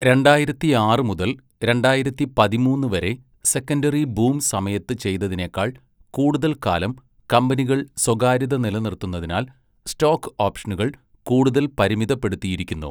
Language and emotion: Malayalam, neutral